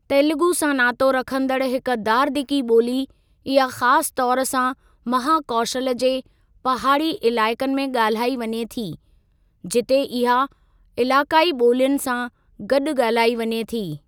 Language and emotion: Sindhi, neutral